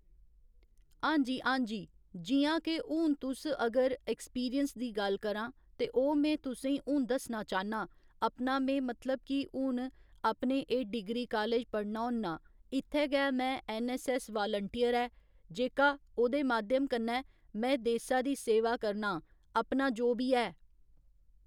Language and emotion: Dogri, neutral